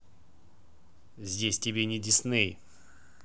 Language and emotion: Russian, angry